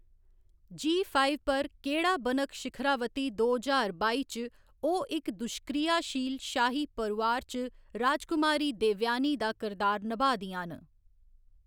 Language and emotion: Dogri, neutral